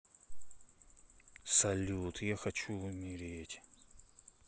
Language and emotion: Russian, sad